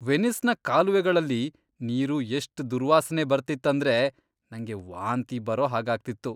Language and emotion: Kannada, disgusted